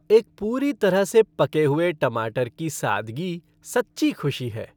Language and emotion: Hindi, happy